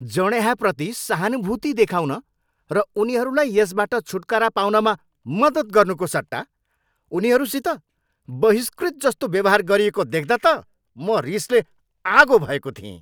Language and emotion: Nepali, angry